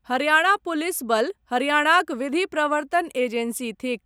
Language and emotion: Maithili, neutral